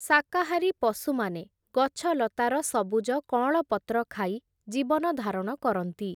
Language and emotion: Odia, neutral